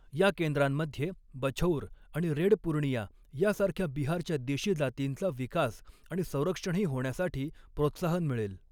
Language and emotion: Marathi, neutral